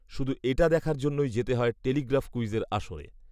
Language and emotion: Bengali, neutral